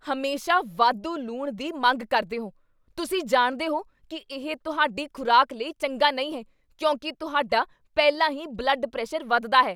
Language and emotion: Punjabi, angry